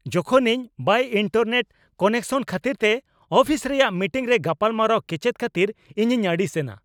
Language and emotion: Santali, angry